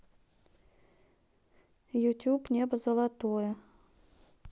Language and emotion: Russian, neutral